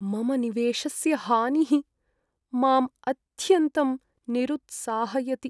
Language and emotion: Sanskrit, sad